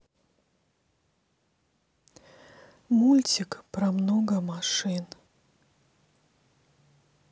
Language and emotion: Russian, sad